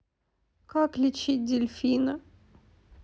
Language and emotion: Russian, sad